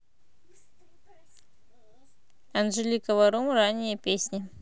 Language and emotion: Russian, neutral